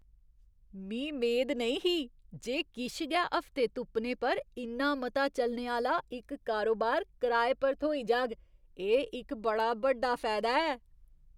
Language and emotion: Dogri, surprised